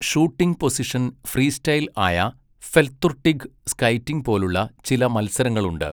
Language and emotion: Malayalam, neutral